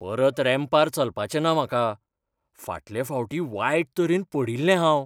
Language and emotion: Goan Konkani, fearful